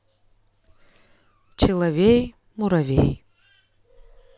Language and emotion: Russian, neutral